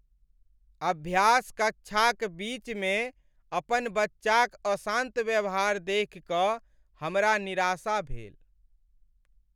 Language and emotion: Maithili, sad